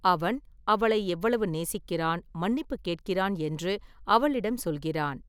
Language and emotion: Tamil, neutral